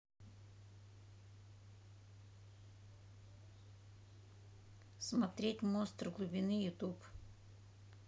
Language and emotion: Russian, neutral